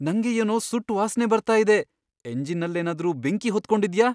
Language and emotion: Kannada, fearful